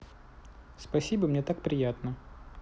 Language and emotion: Russian, positive